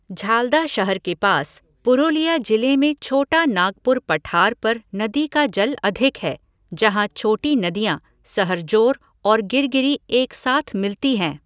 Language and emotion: Hindi, neutral